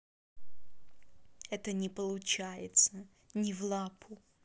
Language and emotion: Russian, neutral